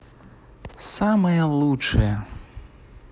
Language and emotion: Russian, positive